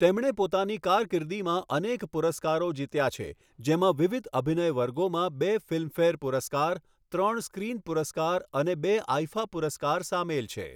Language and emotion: Gujarati, neutral